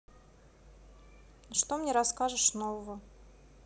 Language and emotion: Russian, neutral